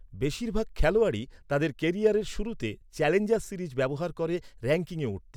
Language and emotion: Bengali, neutral